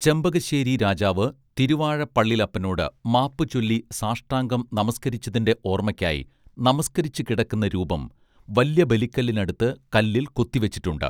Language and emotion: Malayalam, neutral